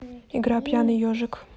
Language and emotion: Russian, neutral